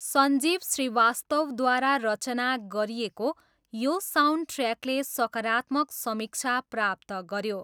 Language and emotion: Nepali, neutral